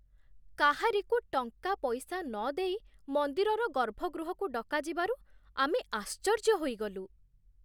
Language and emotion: Odia, surprised